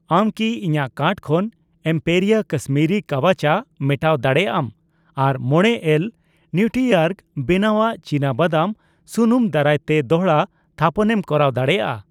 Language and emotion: Santali, neutral